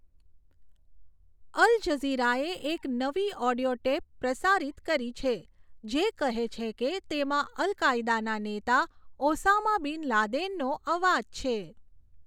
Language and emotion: Gujarati, neutral